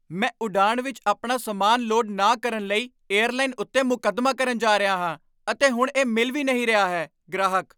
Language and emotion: Punjabi, angry